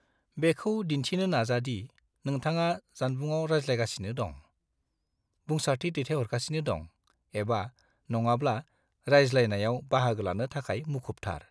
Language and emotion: Bodo, neutral